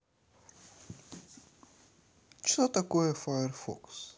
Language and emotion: Russian, neutral